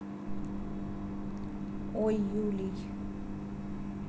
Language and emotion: Russian, neutral